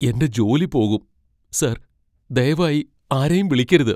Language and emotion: Malayalam, fearful